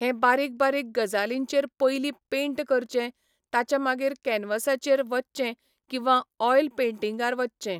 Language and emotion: Goan Konkani, neutral